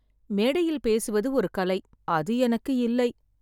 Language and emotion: Tamil, sad